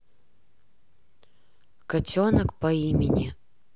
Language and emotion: Russian, neutral